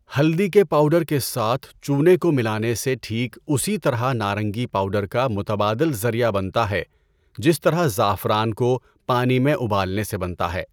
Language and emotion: Urdu, neutral